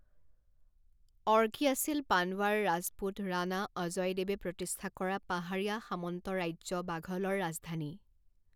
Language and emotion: Assamese, neutral